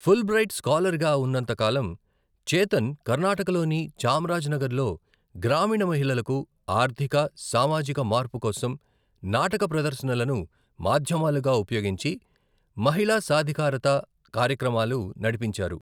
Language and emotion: Telugu, neutral